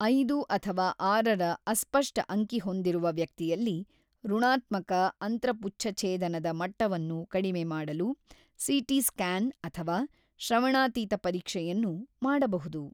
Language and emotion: Kannada, neutral